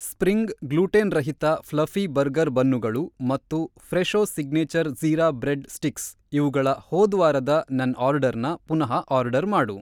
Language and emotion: Kannada, neutral